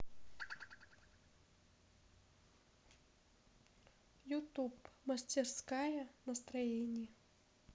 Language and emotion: Russian, neutral